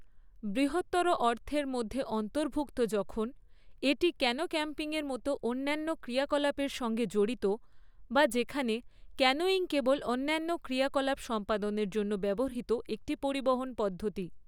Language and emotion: Bengali, neutral